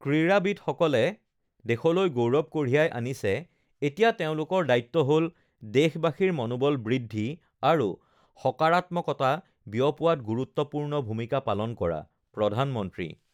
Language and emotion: Assamese, neutral